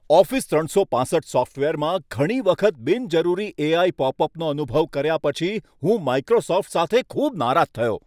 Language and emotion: Gujarati, angry